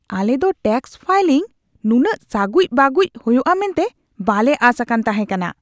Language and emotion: Santali, disgusted